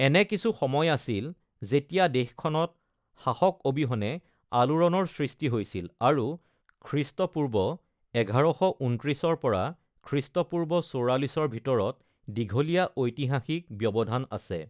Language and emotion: Assamese, neutral